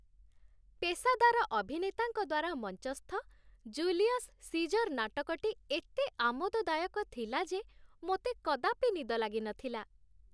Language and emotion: Odia, happy